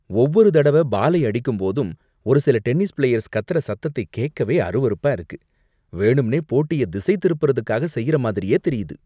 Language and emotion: Tamil, disgusted